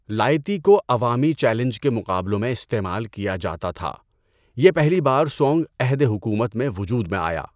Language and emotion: Urdu, neutral